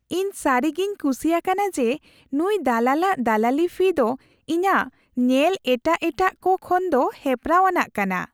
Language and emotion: Santali, happy